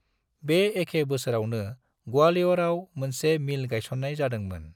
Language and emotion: Bodo, neutral